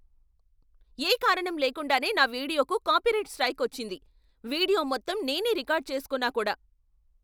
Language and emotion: Telugu, angry